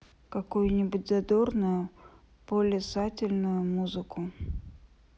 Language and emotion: Russian, sad